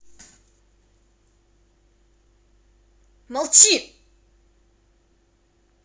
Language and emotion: Russian, angry